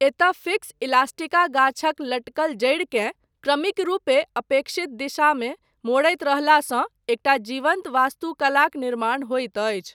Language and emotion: Maithili, neutral